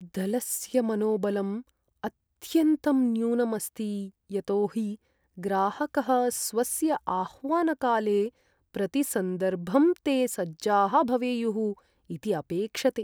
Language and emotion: Sanskrit, sad